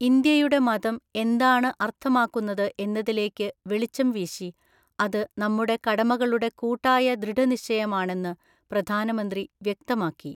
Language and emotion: Malayalam, neutral